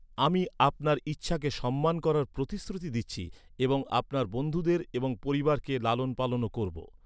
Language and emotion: Bengali, neutral